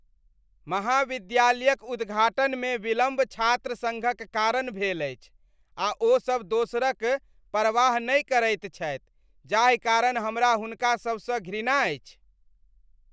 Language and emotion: Maithili, disgusted